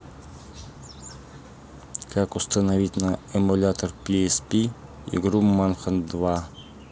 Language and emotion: Russian, neutral